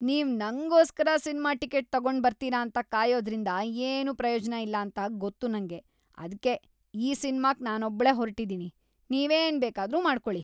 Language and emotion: Kannada, disgusted